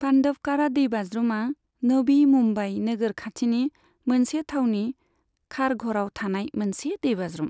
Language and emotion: Bodo, neutral